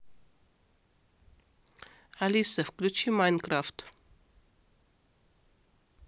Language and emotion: Russian, neutral